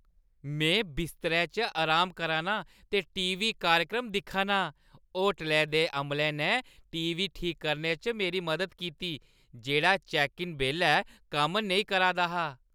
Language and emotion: Dogri, happy